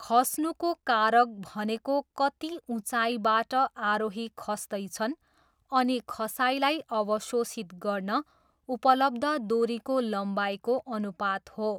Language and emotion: Nepali, neutral